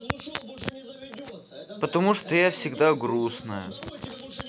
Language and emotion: Russian, neutral